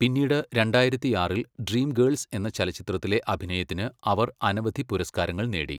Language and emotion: Malayalam, neutral